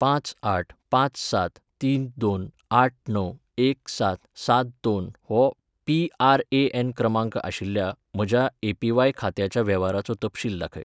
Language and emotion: Goan Konkani, neutral